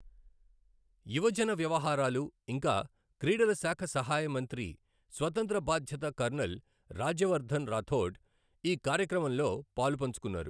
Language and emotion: Telugu, neutral